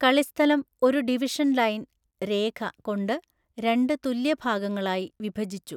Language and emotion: Malayalam, neutral